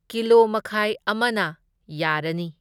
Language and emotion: Manipuri, neutral